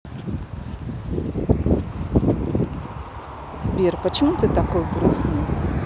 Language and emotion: Russian, sad